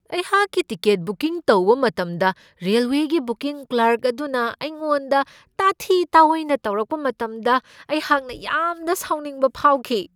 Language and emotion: Manipuri, angry